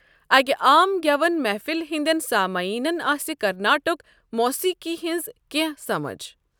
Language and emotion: Kashmiri, neutral